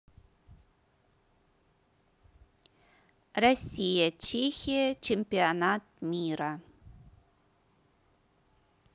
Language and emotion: Russian, neutral